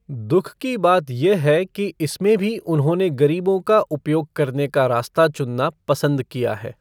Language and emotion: Hindi, neutral